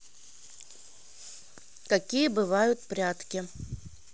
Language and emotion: Russian, neutral